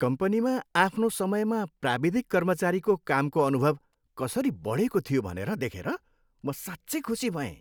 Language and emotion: Nepali, happy